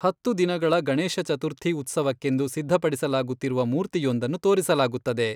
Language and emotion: Kannada, neutral